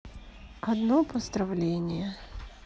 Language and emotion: Russian, sad